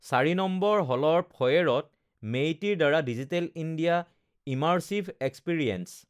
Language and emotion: Assamese, neutral